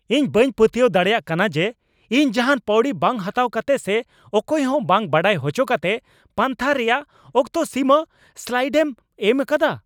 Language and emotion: Santali, angry